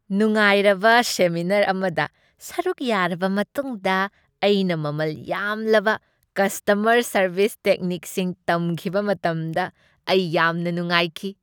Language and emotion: Manipuri, happy